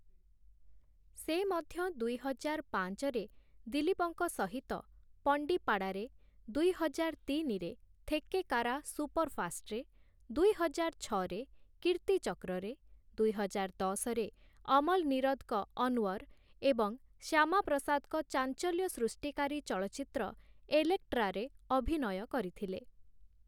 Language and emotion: Odia, neutral